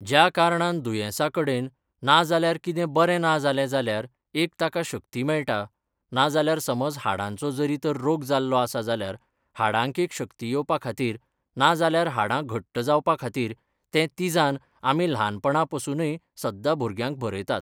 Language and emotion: Goan Konkani, neutral